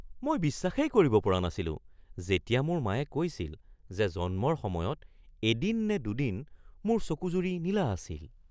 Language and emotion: Assamese, surprised